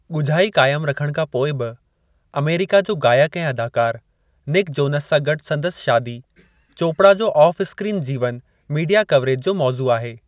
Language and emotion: Sindhi, neutral